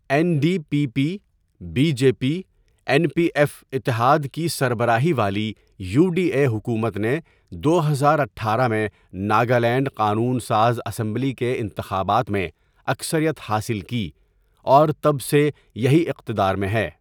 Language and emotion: Urdu, neutral